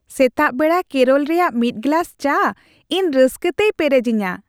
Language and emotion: Santali, happy